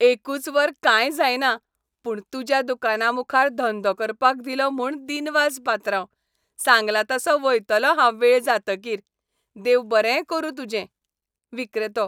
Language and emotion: Goan Konkani, happy